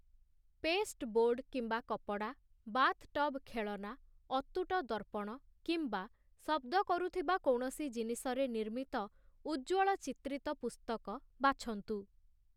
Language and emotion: Odia, neutral